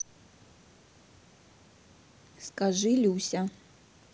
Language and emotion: Russian, neutral